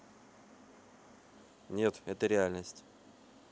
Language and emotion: Russian, neutral